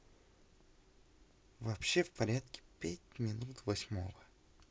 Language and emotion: Russian, neutral